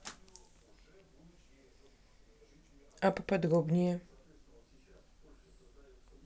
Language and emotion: Russian, neutral